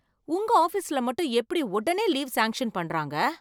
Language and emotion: Tamil, surprised